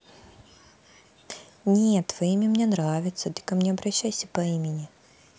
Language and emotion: Russian, positive